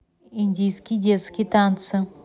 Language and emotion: Russian, neutral